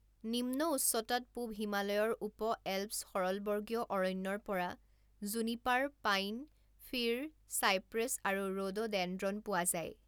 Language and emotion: Assamese, neutral